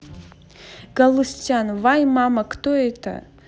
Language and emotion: Russian, positive